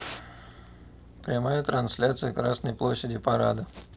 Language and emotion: Russian, neutral